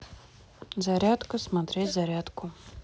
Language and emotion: Russian, neutral